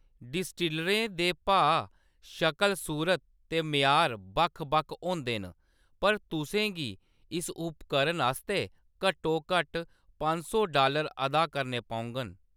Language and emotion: Dogri, neutral